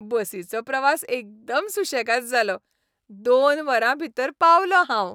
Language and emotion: Goan Konkani, happy